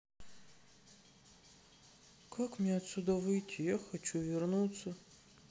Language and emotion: Russian, sad